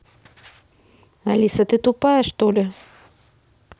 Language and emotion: Russian, angry